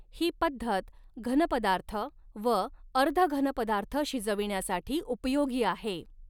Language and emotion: Marathi, neutral